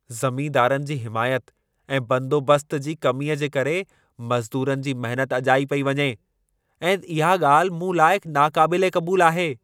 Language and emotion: Sindhi, angry